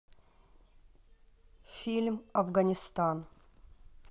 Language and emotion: Russian, neutral